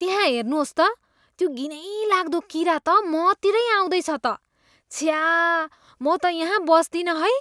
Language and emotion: Nepali, disgusted